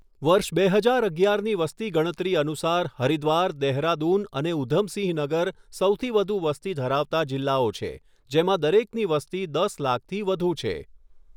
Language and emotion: Gujarati, neutral